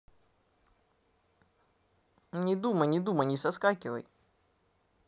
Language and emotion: Russian, neutral